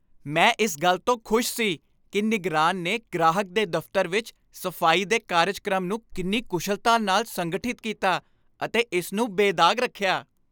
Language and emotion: Punjabi, happy